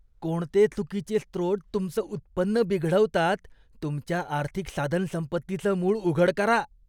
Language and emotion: Marathi, disgusted